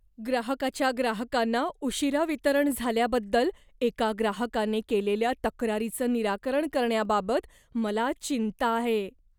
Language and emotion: Marathi, fearful